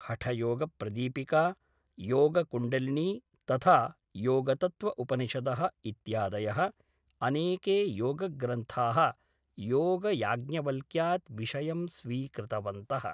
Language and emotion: Sanskrit, neutral